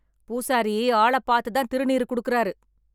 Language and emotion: Tamil, angry